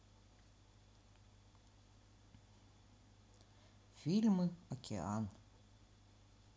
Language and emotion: Russian, neutral